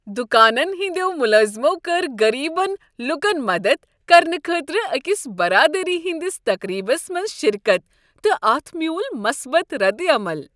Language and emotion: Kashmiri, happy